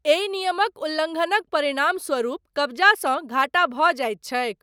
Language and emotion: Maithili, neutral